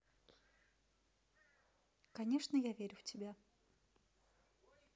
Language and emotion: Russian, neutral